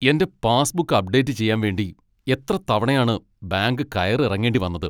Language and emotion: Malayalam, angry